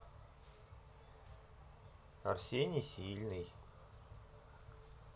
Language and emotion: Russian, neutral